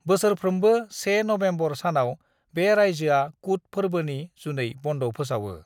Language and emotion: Bodo, neutral